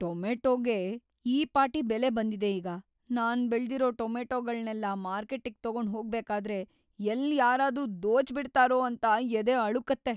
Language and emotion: Kannada, fearful